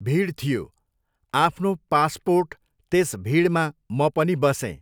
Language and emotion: Nepali, neutral